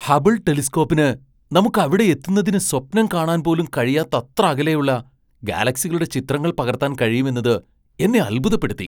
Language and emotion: Malayalam, surprised